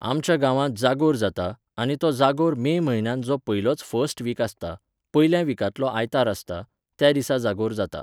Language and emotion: Goan Konkani, neutral